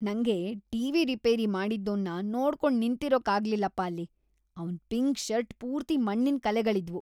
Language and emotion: Kannada, disgusted